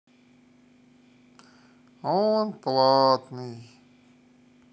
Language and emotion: Russian, sad